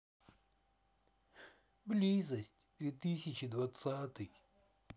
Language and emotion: Russian, sad